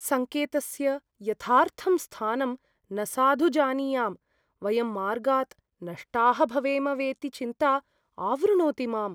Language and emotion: Sanskrit, fearful